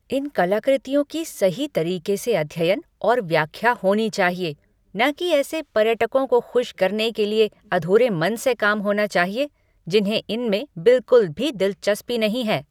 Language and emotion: Hindi, angry